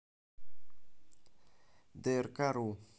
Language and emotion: Russian, neutral